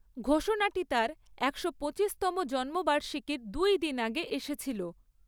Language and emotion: Bengali, neutral